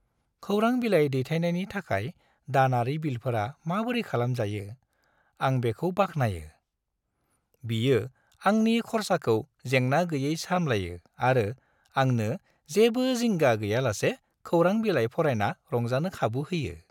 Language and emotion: Bodo, happy